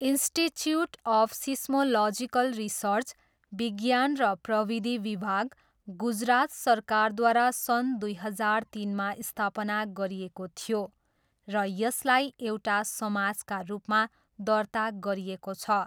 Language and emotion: Nepali, neutral